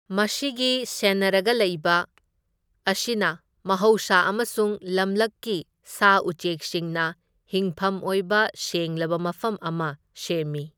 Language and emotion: Manipuri, neutral